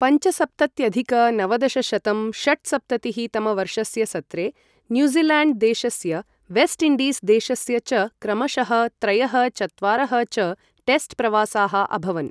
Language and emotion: Sanskrit, neutral